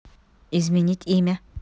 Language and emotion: Russian, neutral